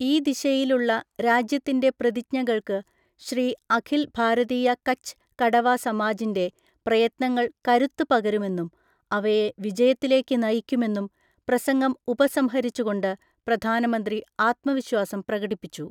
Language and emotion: Malayalam, neutral